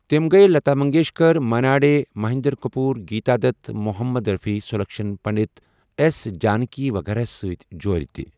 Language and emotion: Kashmiri, neutral